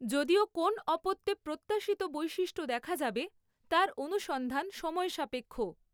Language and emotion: Bengali, neutral